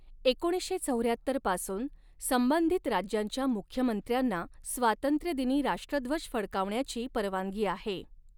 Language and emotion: Marathi, neutral